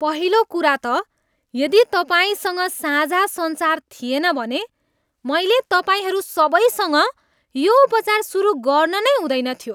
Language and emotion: Nepali, disgusted